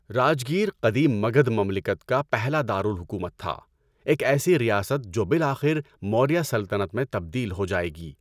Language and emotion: Urdu, neutral